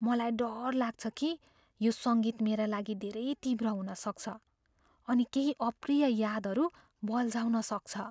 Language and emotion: Nepali, fearful